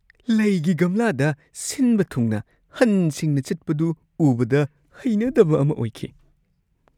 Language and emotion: Manipuri, disgusted